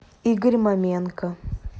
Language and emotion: Russian, neutral